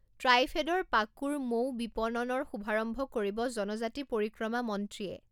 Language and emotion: Assamese, neutral